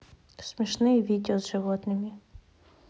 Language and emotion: Russian, neutral